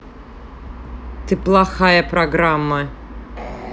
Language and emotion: Russian, angry